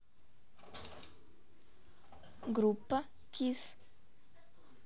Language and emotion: Russian, neutral